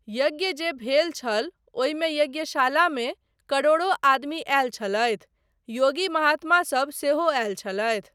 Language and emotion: Maithili, neutral